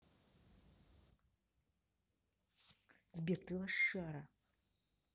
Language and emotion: Russian, angry